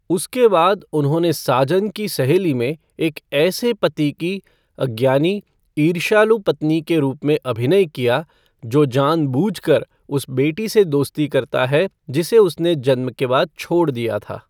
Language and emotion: Hindi, neutral